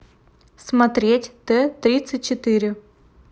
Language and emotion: Russian, neutral